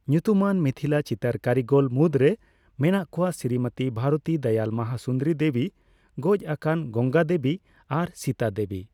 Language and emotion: Santali, neutral